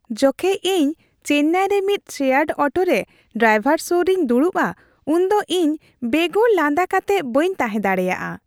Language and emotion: Santali, happy